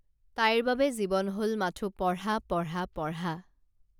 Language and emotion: Assamese, neutral